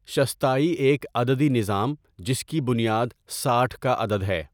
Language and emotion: Urdu, neutral